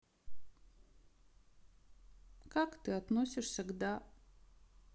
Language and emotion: Russian, sad